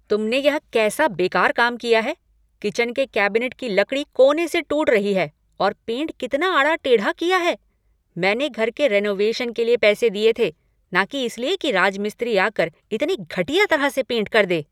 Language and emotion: Hindi, angry